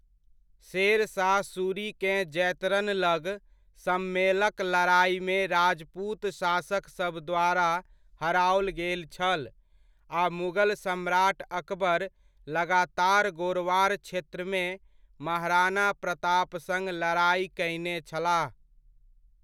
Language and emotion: Maithili, neutral